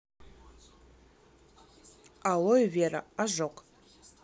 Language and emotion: Russian, neutral